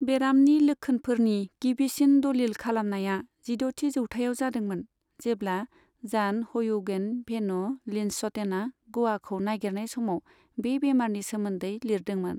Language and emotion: Bodo, neutral